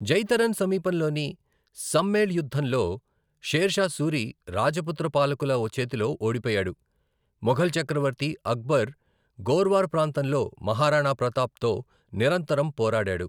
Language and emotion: Telugu, neutral